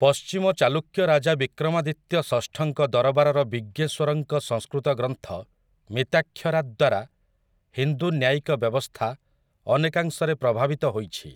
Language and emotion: Odia, neutral